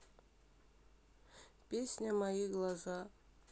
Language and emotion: Russian, sad